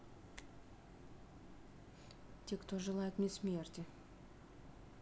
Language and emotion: Russian, neutral